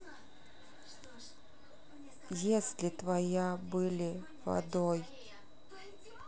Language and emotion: Russian, neutral